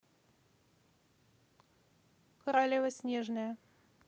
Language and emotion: Russian, neutral